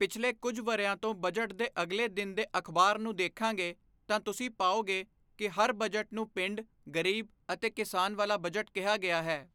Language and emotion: Punjabi, neutral